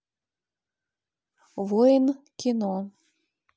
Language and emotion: Russian, neutral